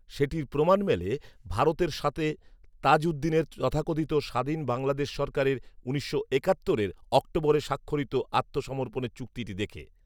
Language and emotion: Bengali, neutral